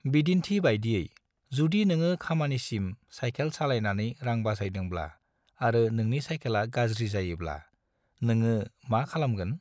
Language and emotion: Bodo, neutral